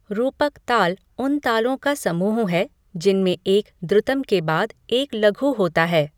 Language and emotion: Hindi, neutral